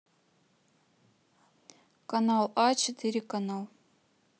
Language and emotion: Russian, neutral